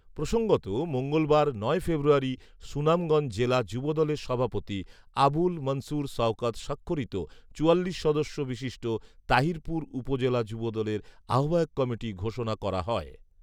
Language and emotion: Bengali, neutral